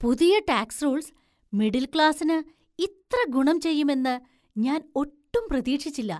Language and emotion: Malayalam, surprised